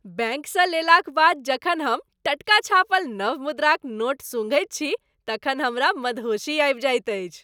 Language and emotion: Maithili, happy